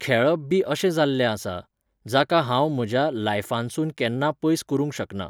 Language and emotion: Goan Konkani, neutral